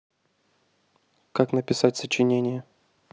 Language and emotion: Russian, neutral